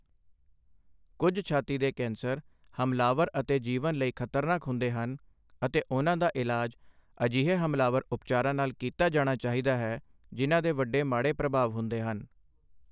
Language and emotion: Punjabi, neutral